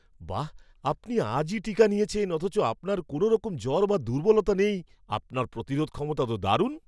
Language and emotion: Bengali, surprised